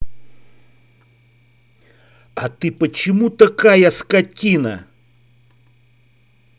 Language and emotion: Russian, angry